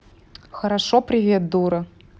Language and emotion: Russian, neutral